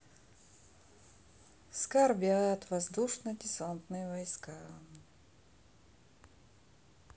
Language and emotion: Russian, sad